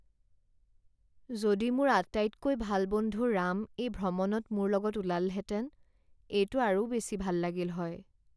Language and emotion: Assamese, sad